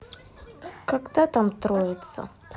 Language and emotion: Russian, sad